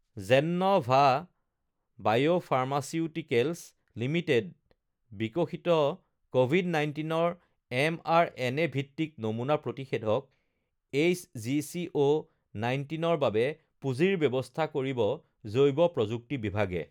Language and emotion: Assamese, neutral